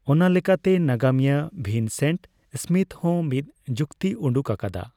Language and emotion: Santali, neutral